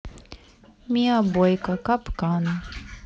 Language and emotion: Russian, neutral